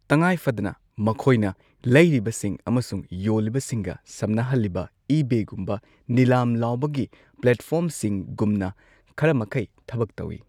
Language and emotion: Manipuri, neutral